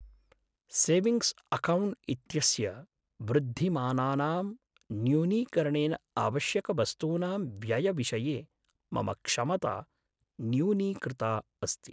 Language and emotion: Sanskrit, sad